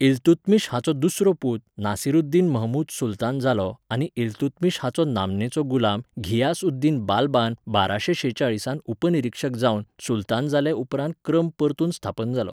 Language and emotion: Goan Konkani, neutral